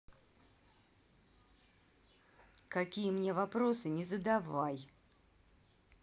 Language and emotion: Russian, angry